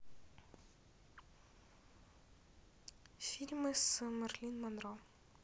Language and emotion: Russian, neutral